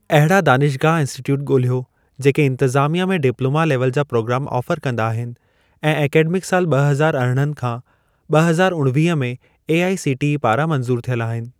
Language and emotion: Sindhi, neutral